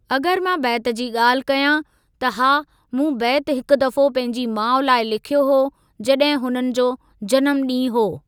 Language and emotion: Sindhi, neutral